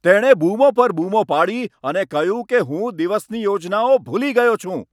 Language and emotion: Gujarati, angry